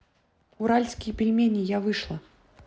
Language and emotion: Russian, neutral